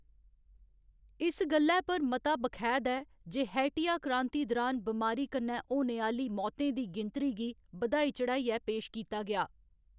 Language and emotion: Dogri, neutral